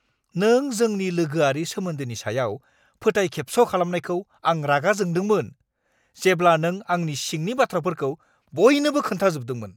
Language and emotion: Bodo, angry